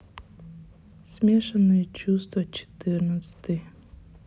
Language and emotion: Russian, sad